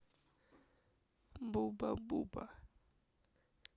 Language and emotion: Russian, neutral